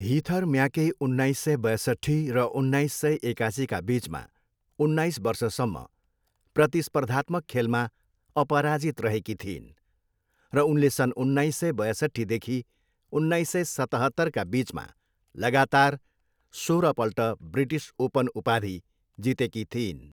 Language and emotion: Nepali, neutral